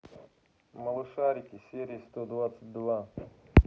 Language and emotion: Russian, neutral